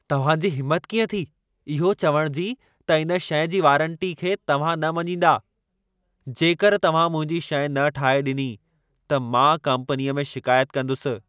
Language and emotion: Sindhi, angry